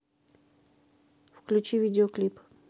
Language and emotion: Russian, neutral